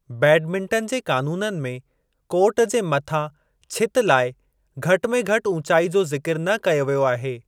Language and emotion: Sindhi, neutral